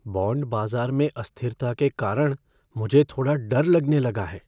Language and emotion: Hindi, fearful